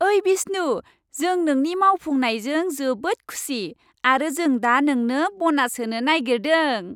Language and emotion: Bodo, happy